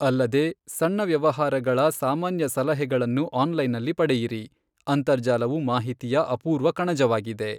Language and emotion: Kannada, neutral